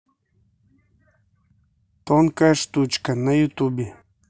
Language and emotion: Russian, neutral